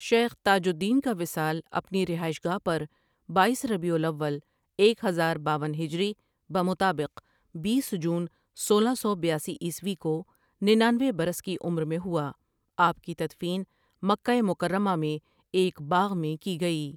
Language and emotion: Urdu, neutral